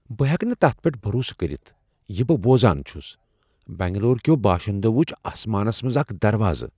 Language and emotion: Kashmiri, surprised